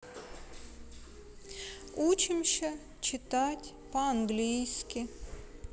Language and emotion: Russian, sad